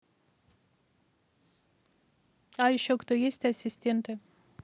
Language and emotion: Russian, neutral